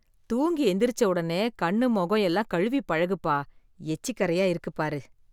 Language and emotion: Tamil, disgusted